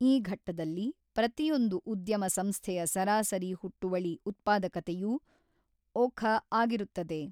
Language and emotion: Kannada, neutral